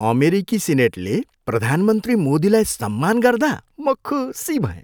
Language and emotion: Nepali, happy